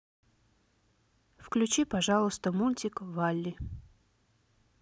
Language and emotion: Russian, neutral